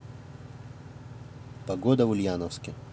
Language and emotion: Russian, neutral